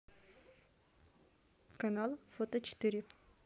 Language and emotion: Russian, neutral